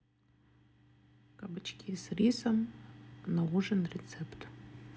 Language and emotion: Russian, neutral